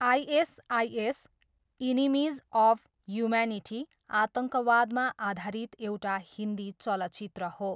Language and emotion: Nepali, neutral